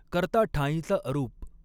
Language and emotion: Marathi, neutral